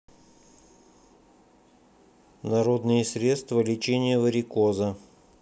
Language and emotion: Russian, neutral